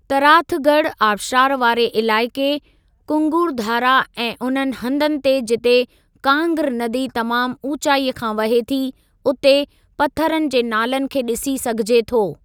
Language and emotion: Sindhi, neutral